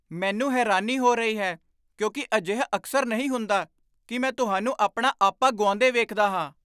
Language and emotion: Punjabi, surprised